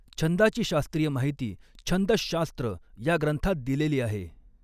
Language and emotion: Marathi, neutral